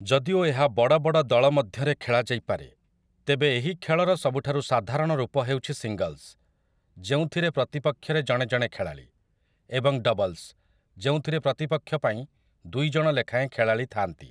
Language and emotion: Odia, neutral